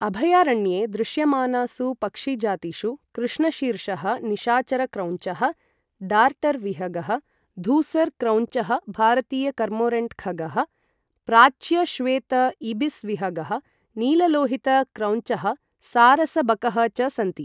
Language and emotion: Sanskrit, neutral